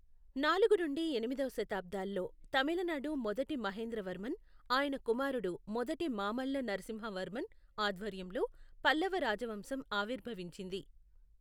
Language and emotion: Telugu, neutral